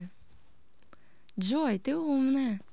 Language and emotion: Russian, positive